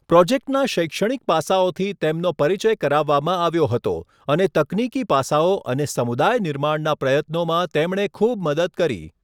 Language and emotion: Gujarati, neutral